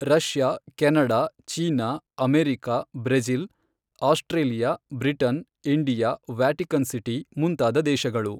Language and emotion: Kannada, neutral